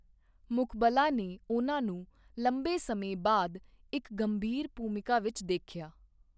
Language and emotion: Punjabi, neutral